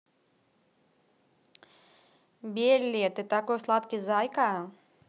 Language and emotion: Russian, positive